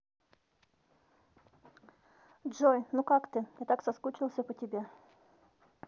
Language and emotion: Russian, neutral